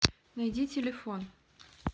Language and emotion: Russian, neutral